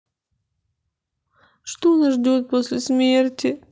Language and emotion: Russian, sad